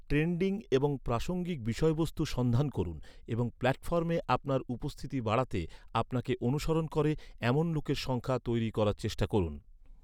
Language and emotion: Bengali, neutral